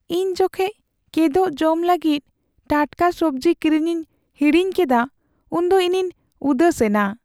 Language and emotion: Santali, sad